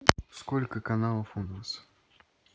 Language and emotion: Russian, neutral